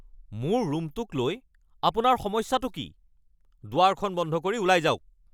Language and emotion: Assamese, angry